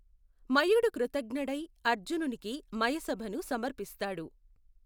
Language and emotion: Telugu, neutral